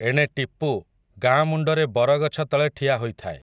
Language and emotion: Odia, neutral